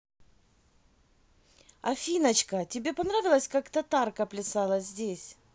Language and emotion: Russian, positive